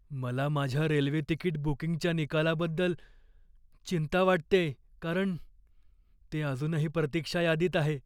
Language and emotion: Marathi, fearful